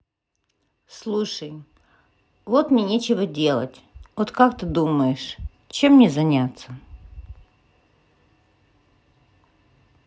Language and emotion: Russian, neutral